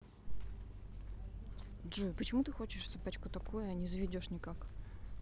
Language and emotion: Russian, neutral